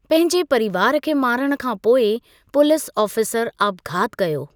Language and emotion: Sindhi, neutral